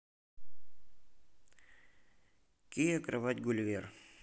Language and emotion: Russian, neutral